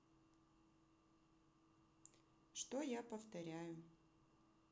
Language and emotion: Russian, neutral